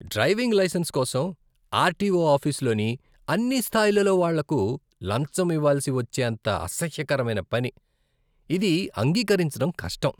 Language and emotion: Telugu, disgusted